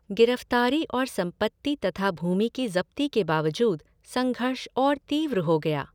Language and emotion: Hindi, neutral